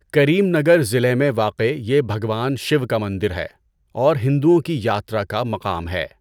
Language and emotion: Urdu, neutral